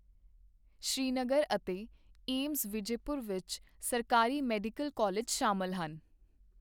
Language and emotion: Punjabi, neutral